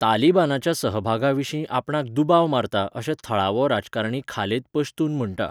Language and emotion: Goan Konkani, neutral